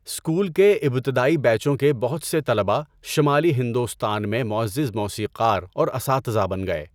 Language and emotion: Urdu, neutral